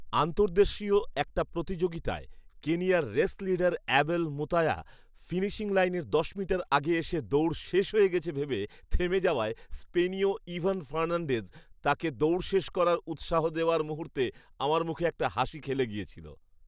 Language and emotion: Bengali, happy